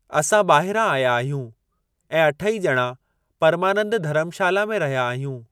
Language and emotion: Sindhi, neutral